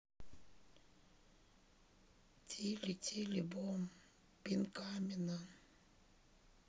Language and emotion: Russian, sad